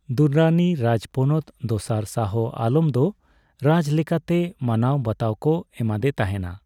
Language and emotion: Santali, neutral